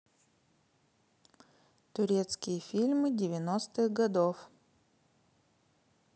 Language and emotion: Russian, neutral